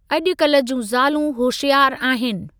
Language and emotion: Sindhi, neutral